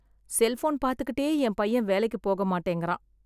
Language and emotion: Tamil, sad